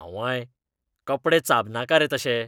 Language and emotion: Goan Konkani, disgusted